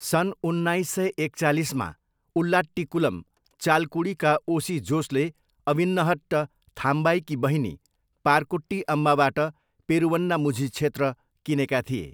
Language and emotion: Nepali, neutral